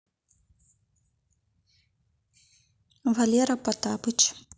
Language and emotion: Russian, neutral